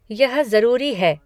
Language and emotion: Hindi, neutral